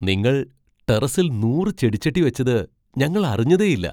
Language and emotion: Malayalam, surprised